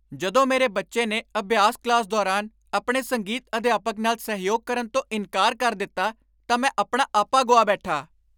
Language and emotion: Punjabi, angry